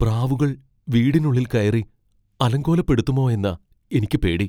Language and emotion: Malayalam, fearful